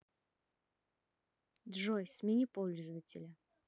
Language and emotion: Russian, neutral